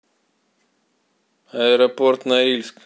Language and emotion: Russian, neutral